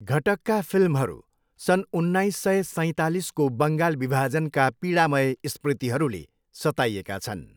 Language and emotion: Nepali, neutral